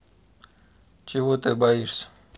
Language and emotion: Russian, neutral